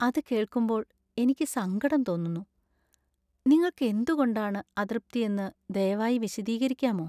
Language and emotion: Malayalam, sad